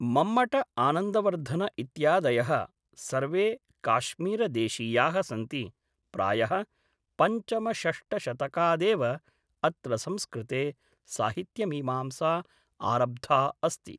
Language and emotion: Sanskrit, neutral